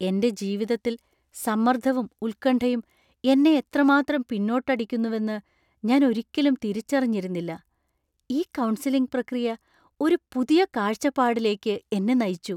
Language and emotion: Malayalam, surprised